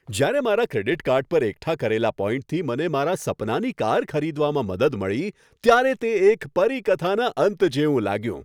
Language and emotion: Gujarati, happy